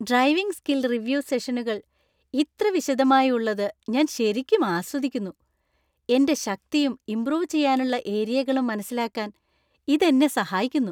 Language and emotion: Malayalam, happy